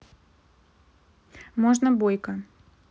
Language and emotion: Russian, neutral